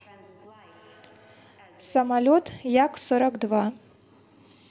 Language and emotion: Russian, neutral